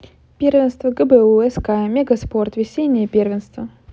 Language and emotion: Russian, positive